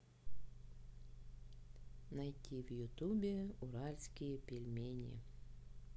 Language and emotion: Russian, sad